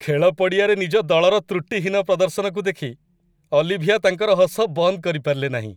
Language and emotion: Odia, happy